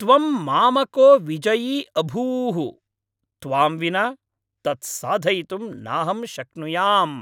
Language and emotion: Sanskrit, happy